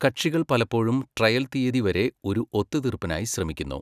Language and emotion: Malayalam, neutral